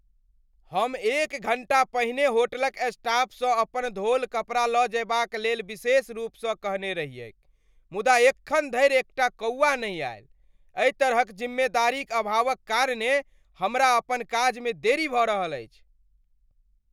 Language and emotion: Maithili, angry